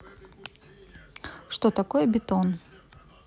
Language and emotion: Russian, neutral